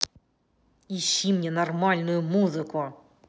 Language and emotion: Russian, angry